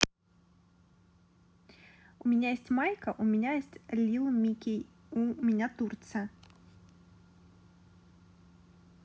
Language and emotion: Russian, positive